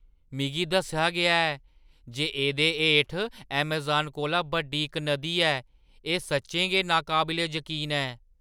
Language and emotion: Dogri, surprised